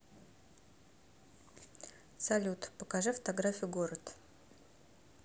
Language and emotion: Russian, neutral